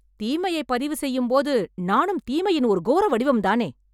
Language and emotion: Tamil, angry